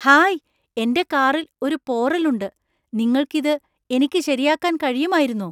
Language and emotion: Malayalam, surprised